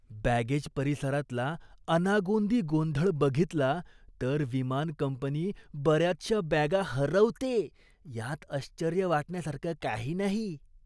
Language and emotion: Marathi, disgusted